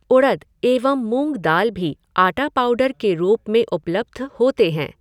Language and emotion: Hindi, neutral